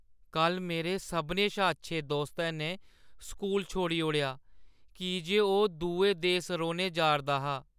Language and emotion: Dogri, sad